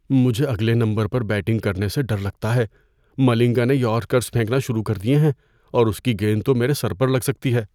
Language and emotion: Urdu, fearful